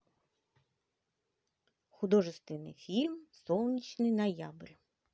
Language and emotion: Russian, positive